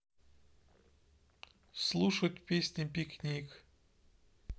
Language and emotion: Russian, neutral